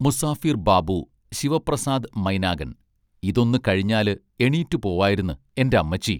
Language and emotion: Malayalam, neutral